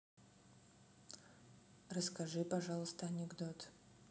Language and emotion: Russian, neutral